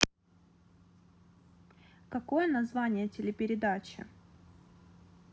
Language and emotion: Russian, neutral